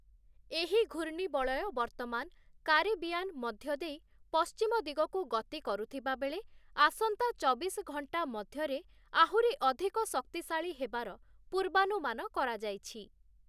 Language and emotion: Odia, neutral